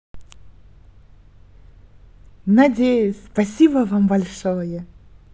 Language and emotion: Russian, positive